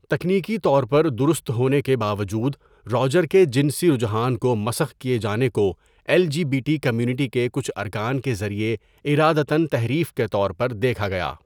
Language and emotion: Urdu, neutral